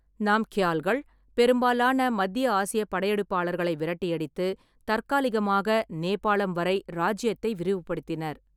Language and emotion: Tamil, neutral